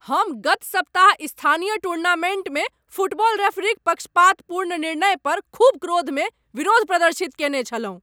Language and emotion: Maithili, angry